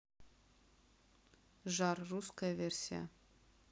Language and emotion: Russian, neutral